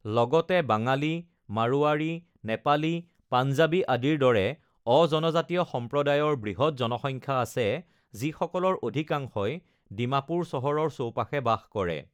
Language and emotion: Assamese, neutral